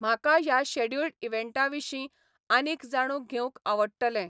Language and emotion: Goan Konkani, neutral